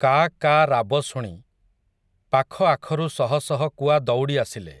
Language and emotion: Odia, neutral